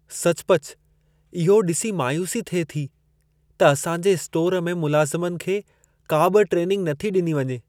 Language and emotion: Sindhi, sad